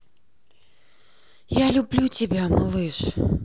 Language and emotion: Russian, sad